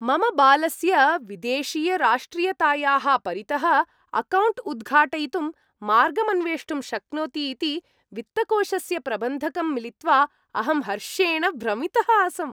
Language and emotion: Sanskrit, happy